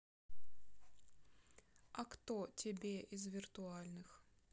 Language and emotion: Russian, neutral